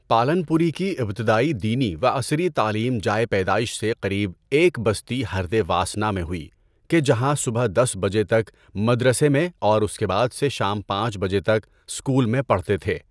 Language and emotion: Urdu, neutral